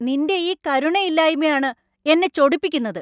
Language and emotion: Malayalam, angry